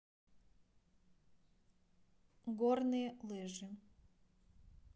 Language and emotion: Russian, neutral